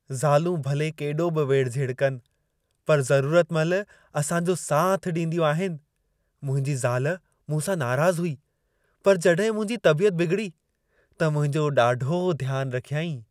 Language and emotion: Sindhi, happy